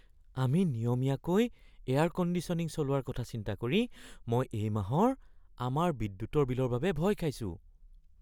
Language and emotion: Assamese, fearful